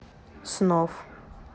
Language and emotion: Russian, neutral